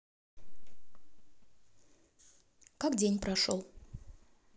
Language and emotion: Russian, neutral